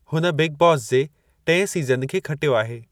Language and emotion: Sindhi, neutral